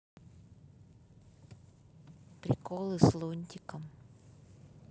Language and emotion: Russian, neutral